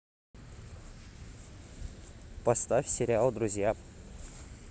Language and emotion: Russian, neutral